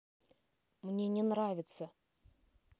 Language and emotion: Russian, neutral